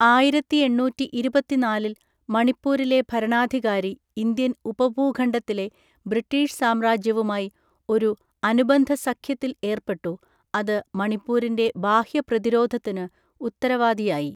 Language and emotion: Malayalam, neutral